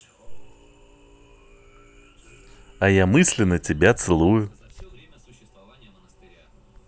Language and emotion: Russian, positive